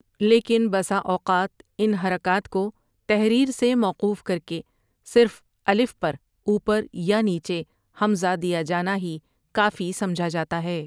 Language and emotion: Urdu, neutral